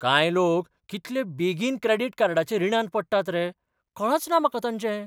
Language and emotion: Goan Konkani, surprised